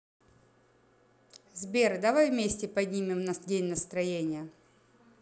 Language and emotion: Russian, positive